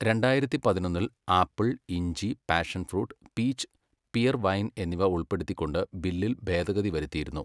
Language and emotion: Malayalam, neutral